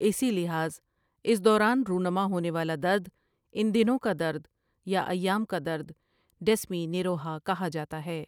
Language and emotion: Urdu, neutral